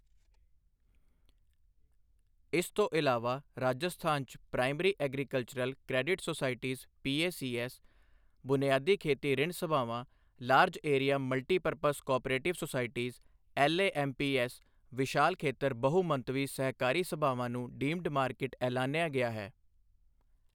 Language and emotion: Punjabi, neutral